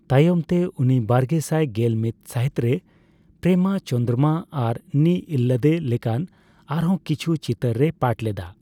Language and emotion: Santali, neutral